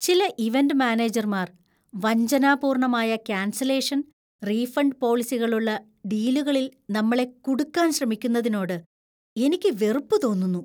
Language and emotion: Malayalam, disgusted